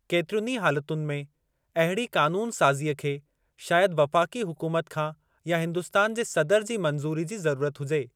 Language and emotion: Sindhi, neutral